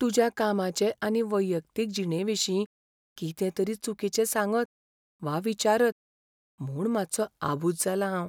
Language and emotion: Goan Konkani, fearful